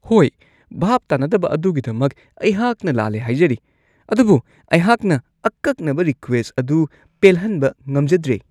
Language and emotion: Manipuri, disgusted